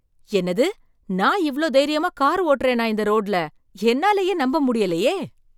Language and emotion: Tamil, surprised